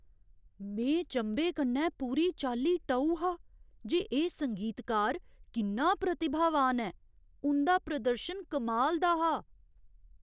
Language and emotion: Dogri, surprised